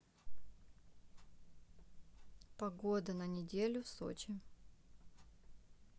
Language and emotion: Russian, neutral